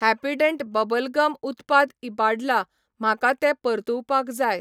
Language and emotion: Goan Konkani, neutral